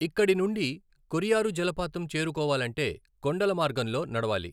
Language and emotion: Telugu, neutral